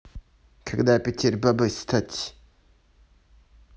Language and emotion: Russian, neutral